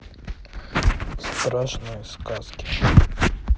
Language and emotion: Russian, neutral